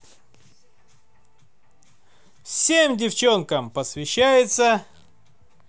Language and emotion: Russian, positive